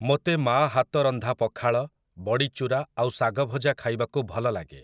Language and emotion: Odia, neutral